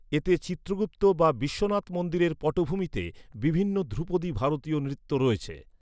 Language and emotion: Bengali, neutral